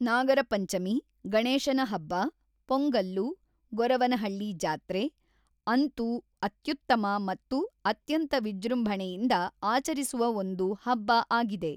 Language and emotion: Kannada, neutral